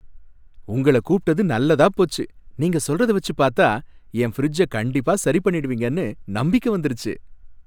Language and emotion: Tamil, happy